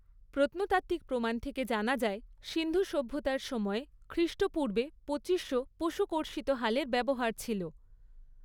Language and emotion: Bengali, neutral